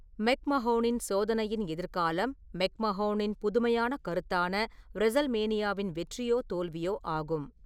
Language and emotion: Tamil, neutral